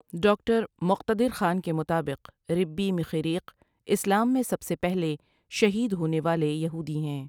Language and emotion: Urdu, neutral